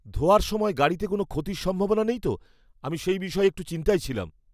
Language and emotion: Bengali, fearful